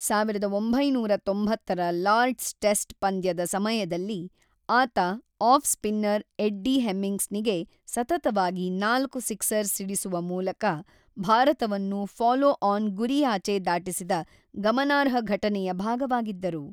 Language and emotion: Kannada, neutral